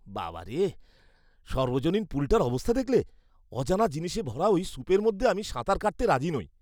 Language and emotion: Bengali, disgusted